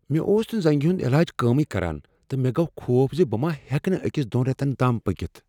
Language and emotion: Kashmiri, fearful